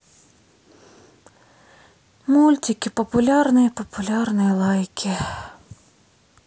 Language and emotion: Russian, sad